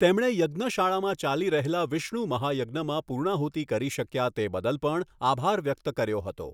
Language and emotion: Gujarati, neutral